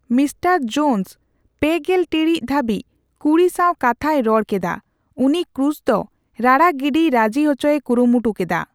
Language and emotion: Santali, neutral